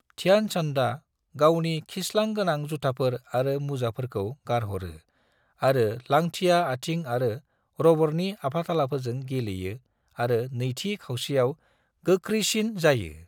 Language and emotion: Bodo, neutral